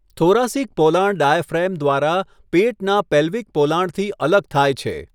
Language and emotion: Gujarati, neutral